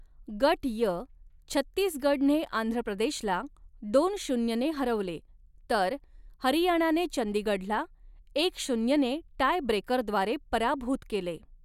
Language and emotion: Marathi, neutral